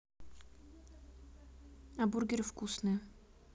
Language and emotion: Russian, neutral